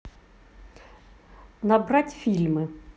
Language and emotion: Russian, neutral